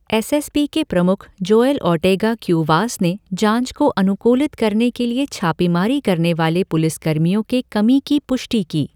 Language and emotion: Hindi, neutral